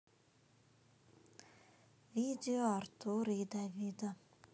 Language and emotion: Russian, sad